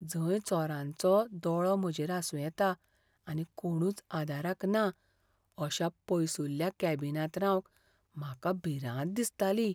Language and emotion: Goan Konkani, fearful